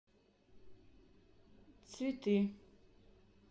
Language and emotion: Russian, neutral